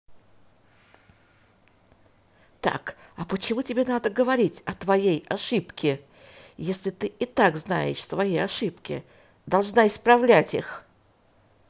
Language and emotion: Russian, angry